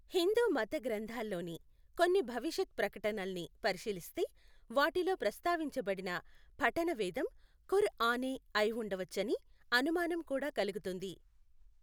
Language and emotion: Telugu, neutral